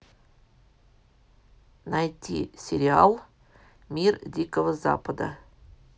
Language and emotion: Russian, neutral